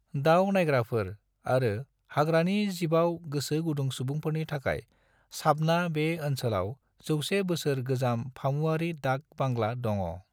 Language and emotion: Bodo, neutral